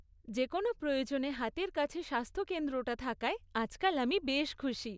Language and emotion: Bengali, happy